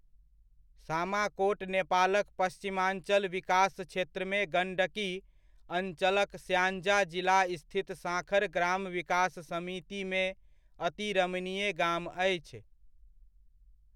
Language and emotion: Maithili, neutral